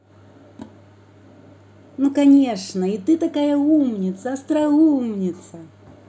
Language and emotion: Russian, positive